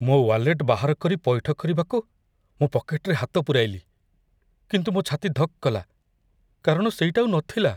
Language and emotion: Odia, fearful